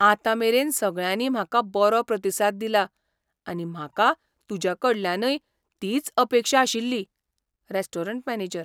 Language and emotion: Goan Konkani, surprised